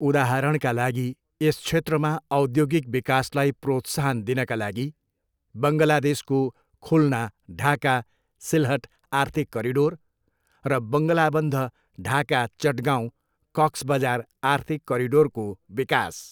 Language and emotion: Nepali, neutral